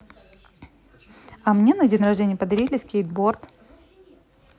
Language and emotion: Russian, positive